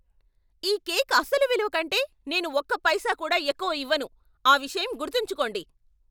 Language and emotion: Telugu, angry